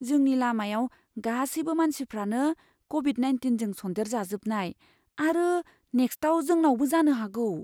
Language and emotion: Bodo, fearful